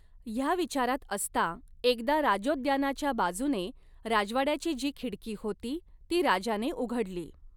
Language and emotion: Marathi, neutral